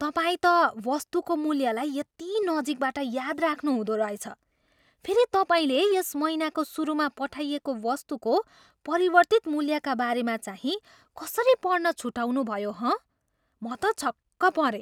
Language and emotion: Nepali, surprised